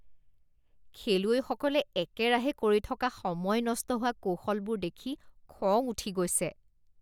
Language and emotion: Assamese, disgusted